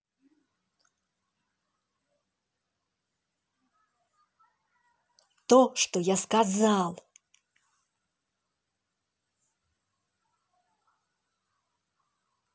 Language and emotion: Russian, angry